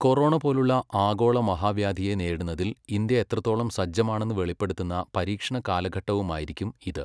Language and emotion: Malayalam, neutral